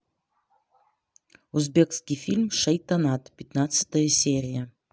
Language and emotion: Russian, neutral